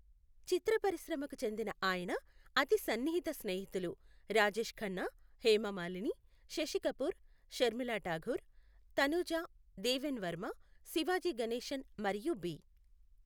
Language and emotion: Telugu, neutral